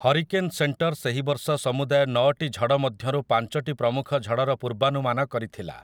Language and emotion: Odia, neutral